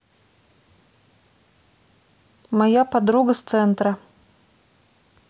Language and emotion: Russian, neutral